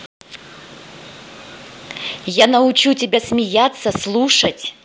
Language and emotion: Russian, angry